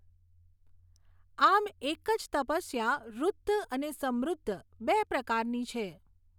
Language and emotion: Gujarati, neutral